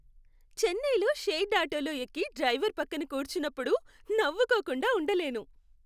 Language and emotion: Telugu, happy